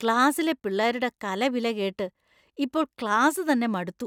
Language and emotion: Malayalam, disgusted